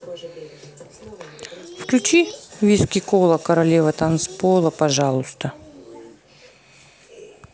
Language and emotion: Russian, neutral